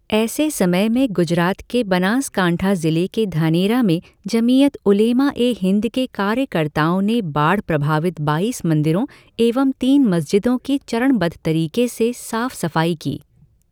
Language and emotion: Hindi, neutral